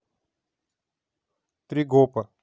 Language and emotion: Russian, neutral